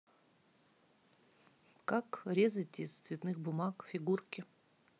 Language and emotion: Russian, neutral